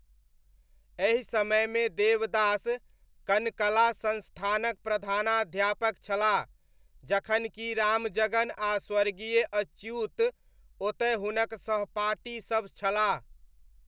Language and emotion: Maithili, neutral